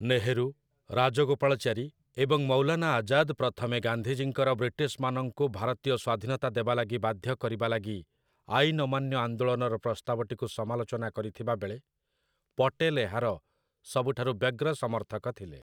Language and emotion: Odia, neutral